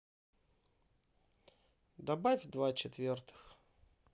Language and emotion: Russian, neutral